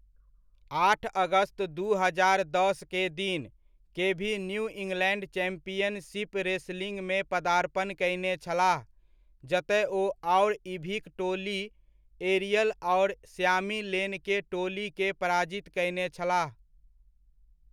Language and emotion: Maithili, neutral